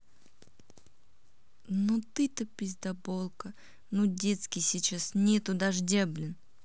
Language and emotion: Russian, angry